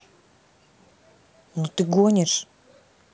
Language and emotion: Russian, angry